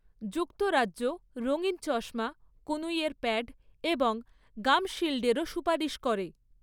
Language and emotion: Bengali, neutral